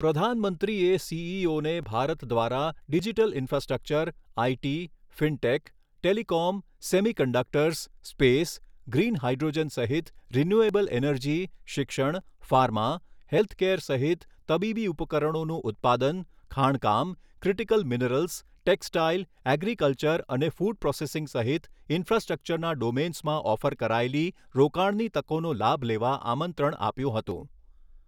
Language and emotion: Gujarati, neutral